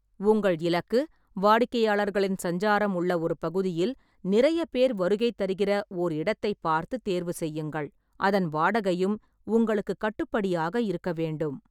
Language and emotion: Tamil, neutral